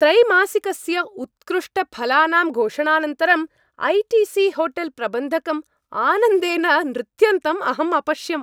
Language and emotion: Sanskrit, happy